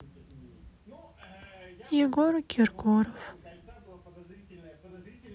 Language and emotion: Russian, sad